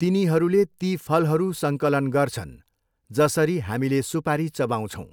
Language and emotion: Nepali, neutral